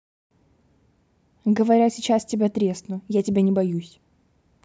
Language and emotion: Russian, angry